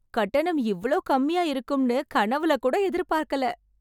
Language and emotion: Tamil, surprised